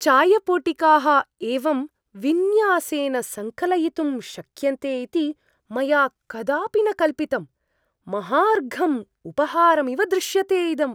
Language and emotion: Sanskrit, surprised